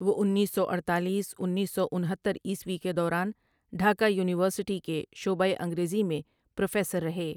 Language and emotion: Urdu, neutral